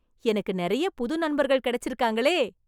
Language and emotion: Tamil, happy